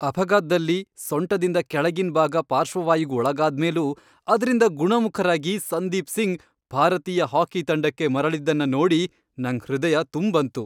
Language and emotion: Kannada, happy